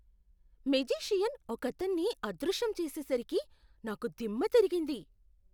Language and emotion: Telugu, surprised